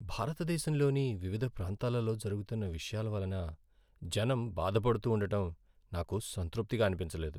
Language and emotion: Telugu, sad